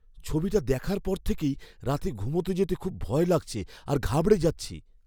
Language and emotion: Bengali, fearful